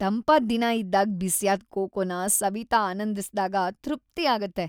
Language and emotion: Kannada, happy